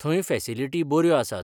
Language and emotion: Goan Konkani, neutral